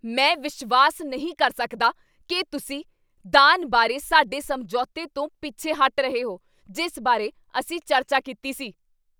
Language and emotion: Punjabi, angry